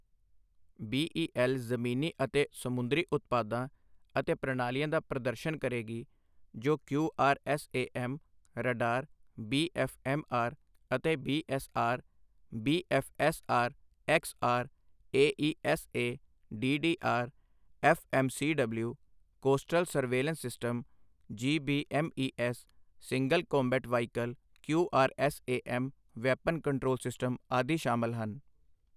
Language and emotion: Punjabi, neutral